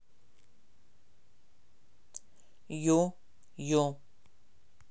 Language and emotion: Russian, neutral